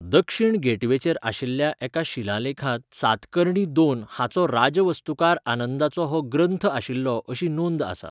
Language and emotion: Goan Konkani, neutral